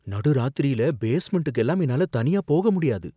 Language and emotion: Tamil, fearful